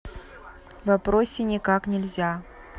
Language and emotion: Russian, neutral